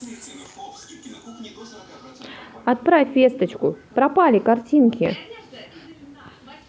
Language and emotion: Russian, sad